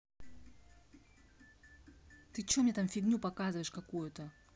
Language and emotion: Russian, angry